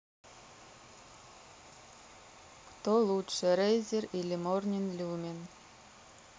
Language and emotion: Russian, neutral